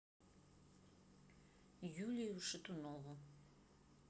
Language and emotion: Russian, neutral